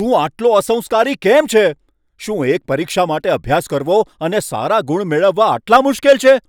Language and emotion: Gujarati, angry